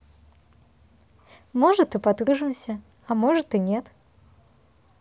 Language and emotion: Russian, positive